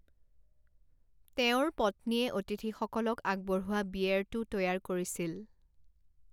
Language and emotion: Assamese, neutral